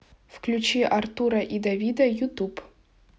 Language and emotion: Russian, neutral